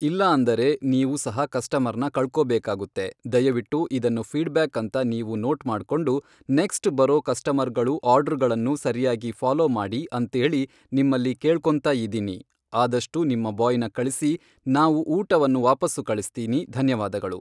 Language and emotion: Kannada, neutral